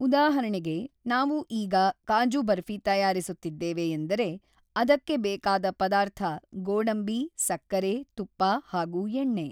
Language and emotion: Kannada, neutral